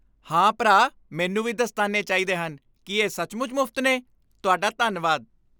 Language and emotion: Punjabi, happy